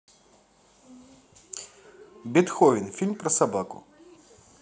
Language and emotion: Russian, positive